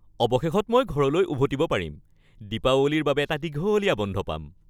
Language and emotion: Assamese, happy